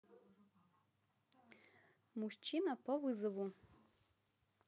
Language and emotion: Russian, positive